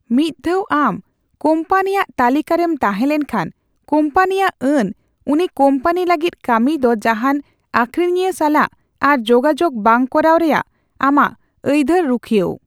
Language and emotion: Santali, neutral